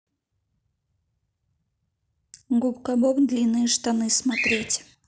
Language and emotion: Russian, neutral